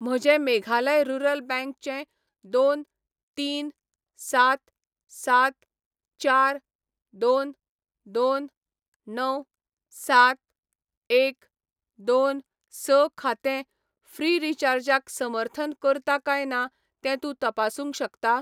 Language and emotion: Goan Konkani, neutral